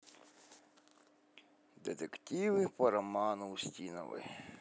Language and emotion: Russian, neutral